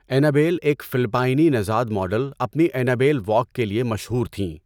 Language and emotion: Urdu, neutral